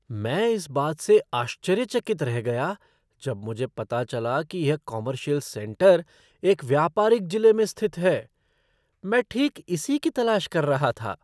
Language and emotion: Hindi, surprised